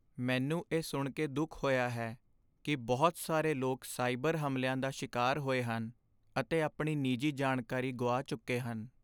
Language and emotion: Punjabi, sad